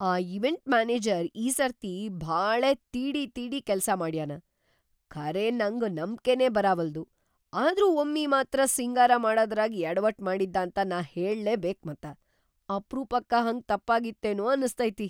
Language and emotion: Kannada, surprised